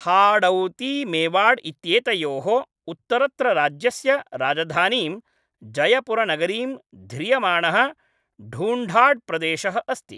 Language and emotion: Sanskrit, neutral